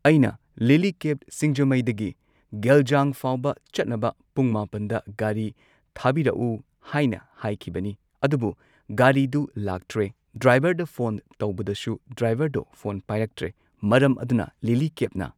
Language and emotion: Manipuri, neutral